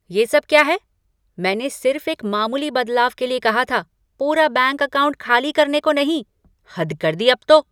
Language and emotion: Hindi, angry